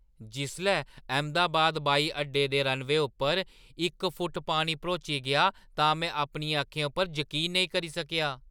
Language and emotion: Dogri, surprised